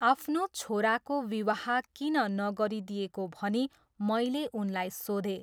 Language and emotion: Nepali, neutral